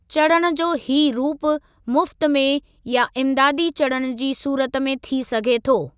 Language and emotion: Sindhi, neutral